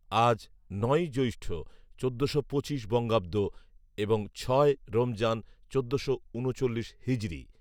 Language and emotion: Bengali, neutral